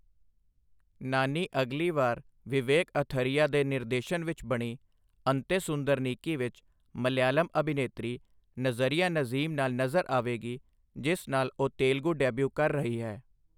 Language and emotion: Punjabi, neutral